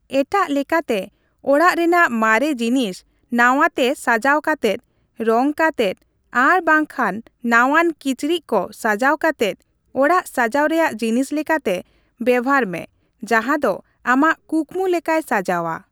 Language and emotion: Santali, neutral